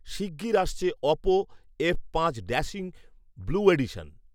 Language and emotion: Bengali, neutral